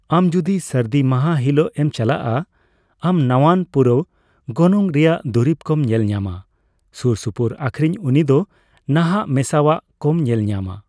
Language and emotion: Santali, neutral